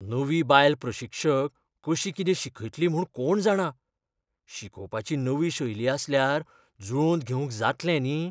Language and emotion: Goan Konkani, fearful